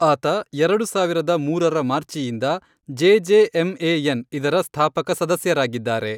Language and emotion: Kannada, neutral